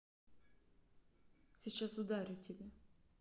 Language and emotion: Russian, neutral